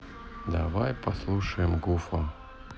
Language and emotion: Russian, neutral